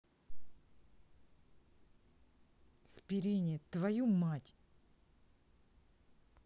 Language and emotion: Russian, angry